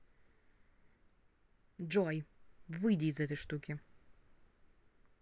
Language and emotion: Russian, angry